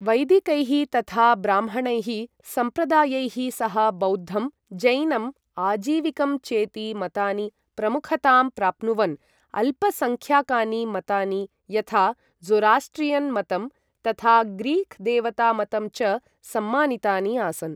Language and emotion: Sanskrit, neutral